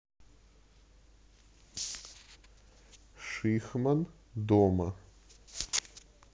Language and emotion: Russian, neutral